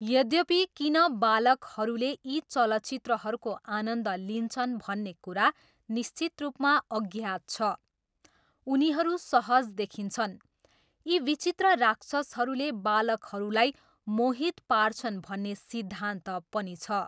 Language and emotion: Nepali, neutral